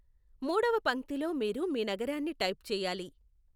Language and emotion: Telugu, neutral